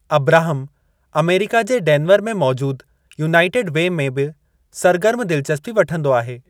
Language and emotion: Sindhi, neutral